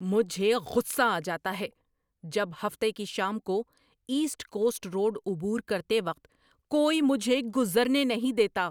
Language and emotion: Urdu, angry